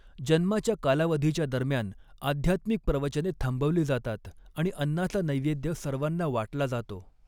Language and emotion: Marathi, neutral